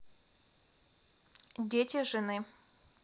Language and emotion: Russian, neutral